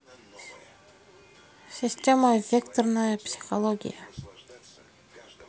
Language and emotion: Russian, neutral